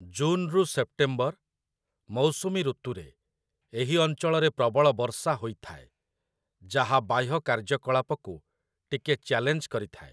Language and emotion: Odia, neutral